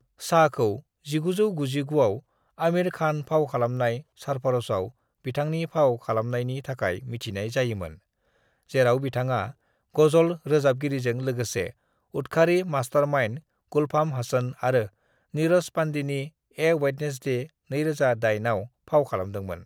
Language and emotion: Bodo, neutral